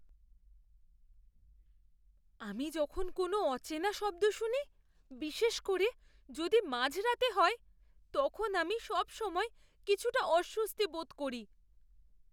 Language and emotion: Bengali, fearful